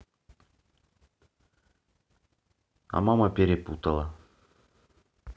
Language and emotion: Russian, neutral